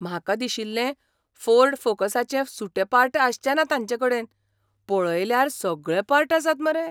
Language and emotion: Goan Konkani, surprised